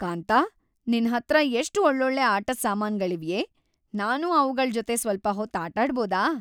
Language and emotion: Kannada, happy